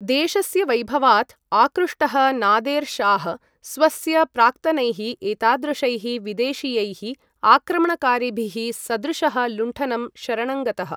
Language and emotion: Sanskrit, neutral